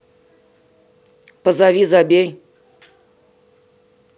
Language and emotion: Russian, neutral